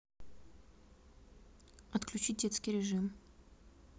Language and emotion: Russian, neutral